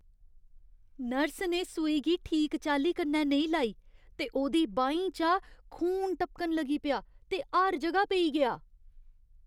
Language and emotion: Dogri, disgusted